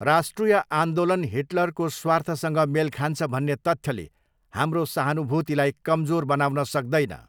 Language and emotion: Nepali, neutral